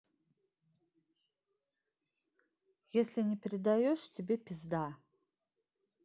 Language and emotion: Russian, angry